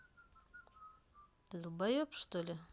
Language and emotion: Russian, angry